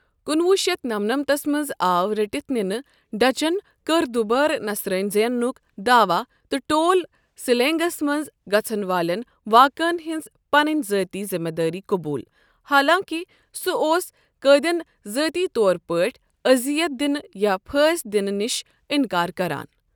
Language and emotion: Kashmiri, neutral